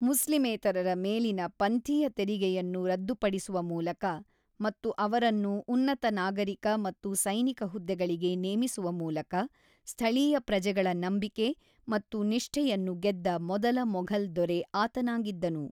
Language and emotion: Kannada, neutral